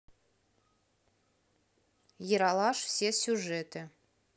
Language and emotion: Russian, neutral